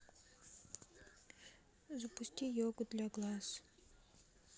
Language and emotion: Russian, sad